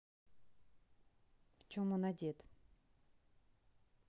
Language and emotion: Russian, neutral